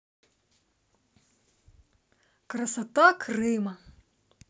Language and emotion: Russian, positive